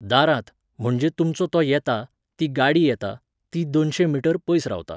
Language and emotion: Goan Konkani, neutral